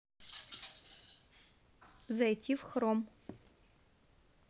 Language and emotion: Russian, neutral